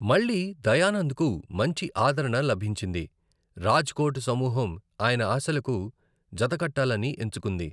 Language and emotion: Telugu, neutral